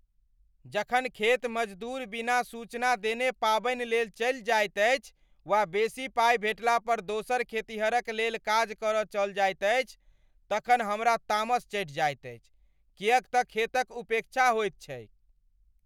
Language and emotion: Maithili, angry